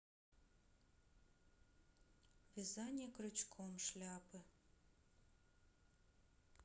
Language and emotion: Russian, neutral